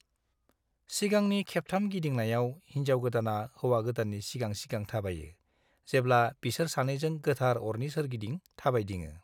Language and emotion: Bodo, neutral